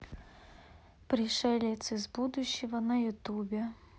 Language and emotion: Russian, neutral